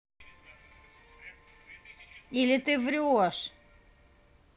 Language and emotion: Russian, angry